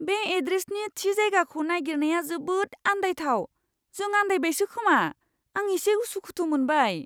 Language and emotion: Bodo, fearful